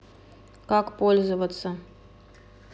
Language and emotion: Russian, neutral